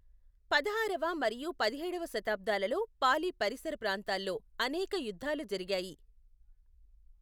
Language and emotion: Telugu, neutral